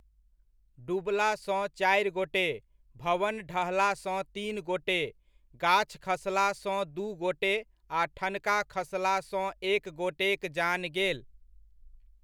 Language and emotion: Maithili, neutral